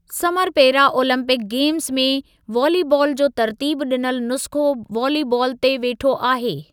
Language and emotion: Sindhi, neutral